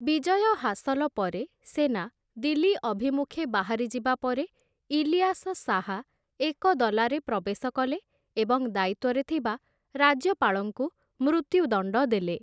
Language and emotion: Odia, neutral